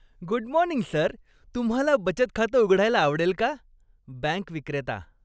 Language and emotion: Marathi, happy